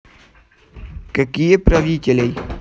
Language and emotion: Russian, neutral